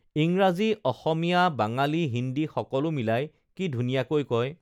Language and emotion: Assamese, neutral